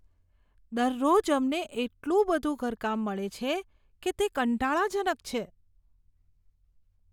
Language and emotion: Gujarati, disgusted